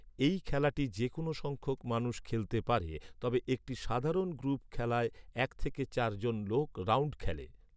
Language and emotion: Bengali, neutral